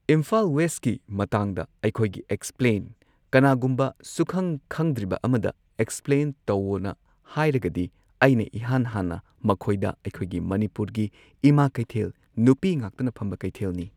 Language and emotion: Manipuri, neutral